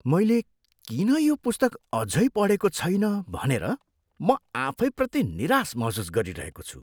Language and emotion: Nepali, disgusted